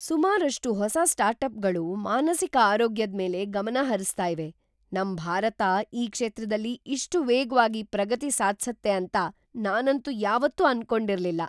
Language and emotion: Kannada, surprised